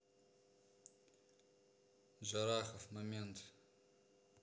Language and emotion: Russian, neutral